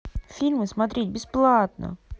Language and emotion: Russian, angry